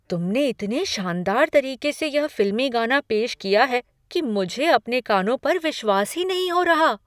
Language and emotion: Hindi, surprised